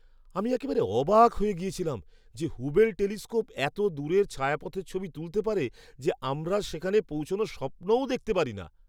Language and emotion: Bengali, surprised